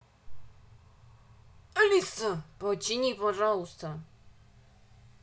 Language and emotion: Russian, angry